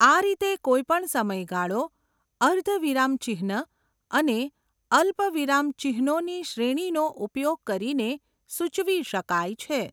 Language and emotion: Gujarati, neutral